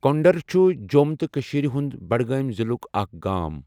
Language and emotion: Kashmiri, neutral